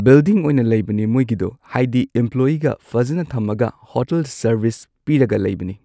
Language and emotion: Manipuri, neutral